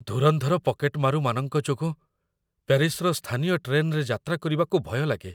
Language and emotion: Odia, fearful